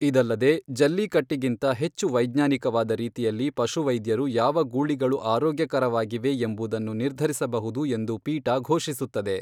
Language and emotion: Kannada, neutral